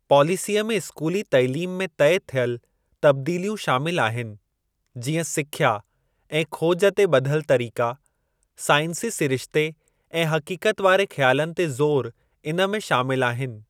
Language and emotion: Sindhi, neutral